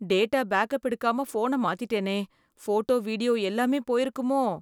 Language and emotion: Tamil, fearful